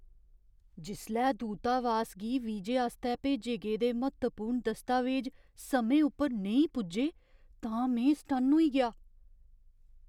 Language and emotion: Dogri, surprised